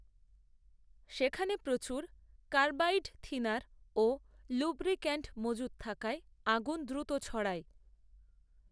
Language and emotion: Bengali, neutral